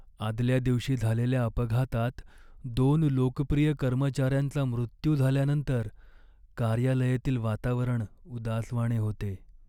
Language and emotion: Marathi, sad